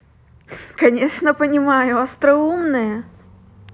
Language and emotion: Russian, positive